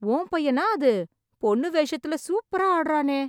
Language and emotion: Tamil, surprised